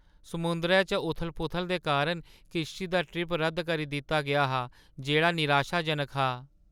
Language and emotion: Dogri, sad